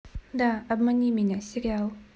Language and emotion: Russian, neutral